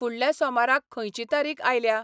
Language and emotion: Goan Konkani, neutral